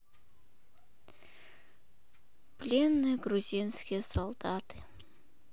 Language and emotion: Russian, sad